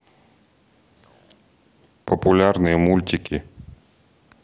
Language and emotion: Russian, neutral